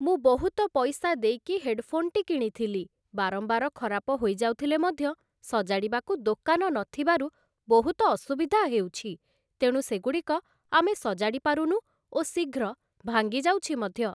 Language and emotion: Odia, neutral